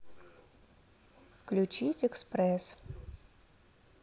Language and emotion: Russian, neutral